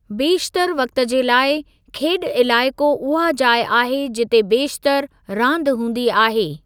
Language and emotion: Sindhi, neutral